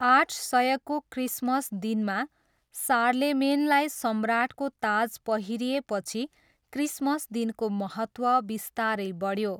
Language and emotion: Nepali, neutral